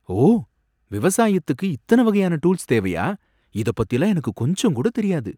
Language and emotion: Tamil, surprised